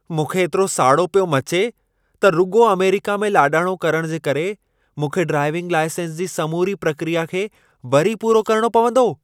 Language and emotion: Sindhi, angry